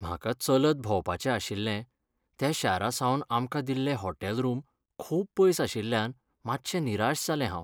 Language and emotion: Goan Konkani, sad